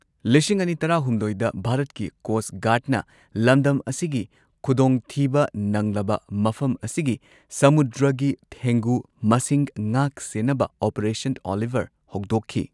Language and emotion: Manipuri, neutral